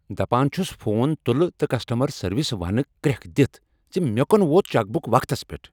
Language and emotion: Kashmiri, angry